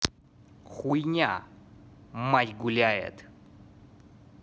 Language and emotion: Russian, angry